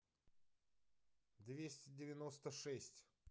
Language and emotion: Russian, neutral